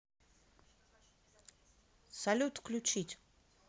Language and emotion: Russian, neutral